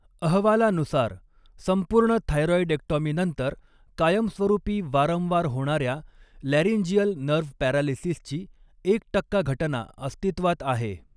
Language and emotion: Marathi, neutral